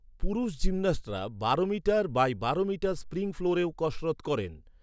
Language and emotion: Bengali, neutral